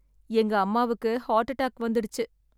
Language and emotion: Tamil, sad